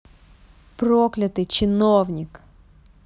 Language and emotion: Russian, angry